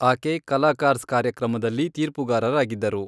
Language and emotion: Kannada, neutral